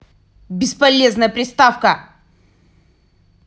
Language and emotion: Russian, angry